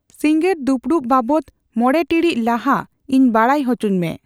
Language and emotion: Santali, neutral